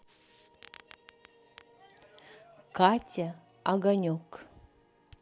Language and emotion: Russian, neutral